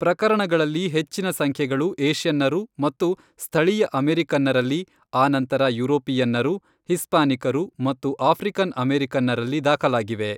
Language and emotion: Kannada, neutral